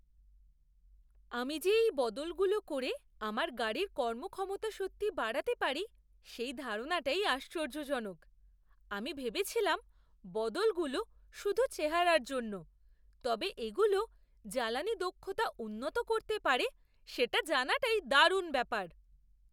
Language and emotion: Bengali, surprised